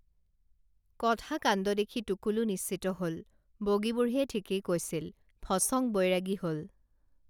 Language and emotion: Assamese, neutral